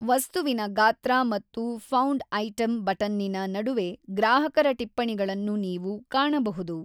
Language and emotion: Kannada, neutral